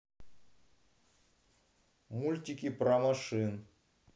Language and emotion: Russian, neutral